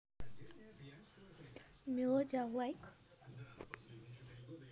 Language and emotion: Russian, neutral